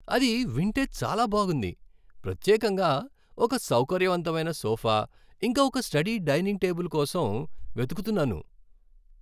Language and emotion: Telugu, happy